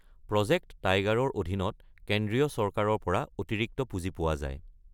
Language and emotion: Assamese, neutral